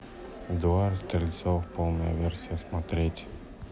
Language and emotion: Russian, neutral